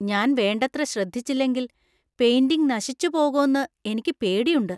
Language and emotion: Malayalam, fearful